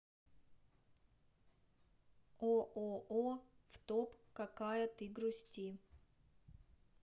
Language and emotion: Russian, neutral